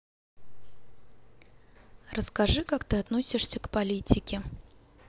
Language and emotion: Russian, neutral